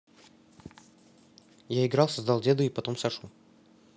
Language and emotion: Russian, neutral